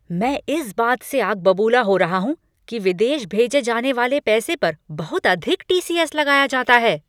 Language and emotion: Hindi, angry